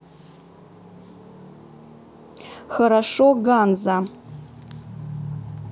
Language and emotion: Russian, neutral